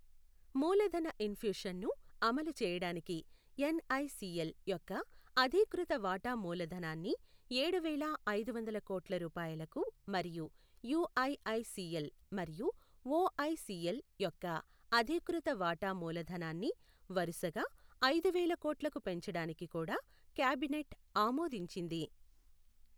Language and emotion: Telugu, neutral